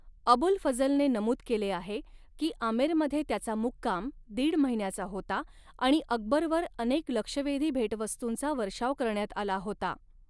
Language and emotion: Marathi, neutral